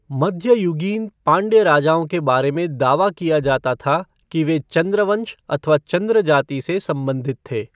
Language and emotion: Hindi, neutral